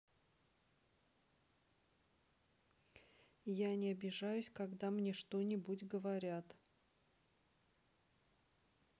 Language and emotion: Russian, neutral